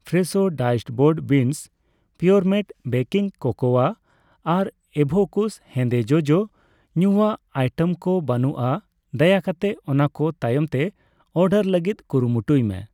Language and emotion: Santali, neutral